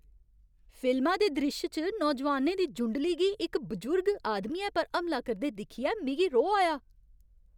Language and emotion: Dogri, angry